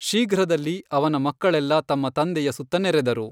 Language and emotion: Kannada, neutral